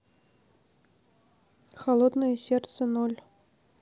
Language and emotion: Russian, neutral